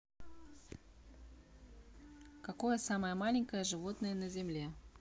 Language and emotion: Russian, neutral